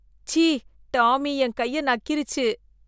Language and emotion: Tamil, disgusted